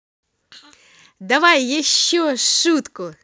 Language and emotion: Russian, positive